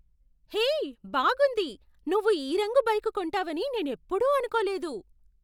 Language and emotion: Telugu, surprised